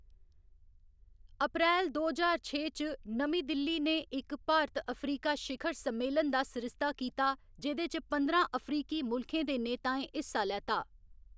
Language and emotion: Dogri, neutral